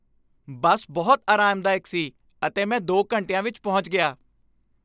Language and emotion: Punjabi, happy